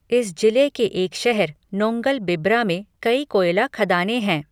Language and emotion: Hindi, neutral